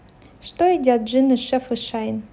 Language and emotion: Russian, neutral